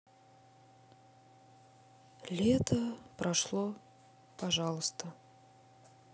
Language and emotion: Russian, sad